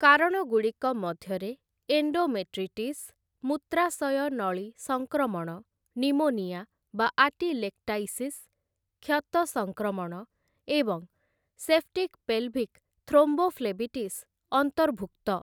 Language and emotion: Odia, neutral